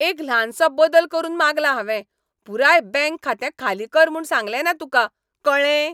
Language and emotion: Goan Konkani, angry